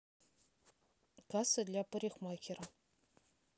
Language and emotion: Russian, neutral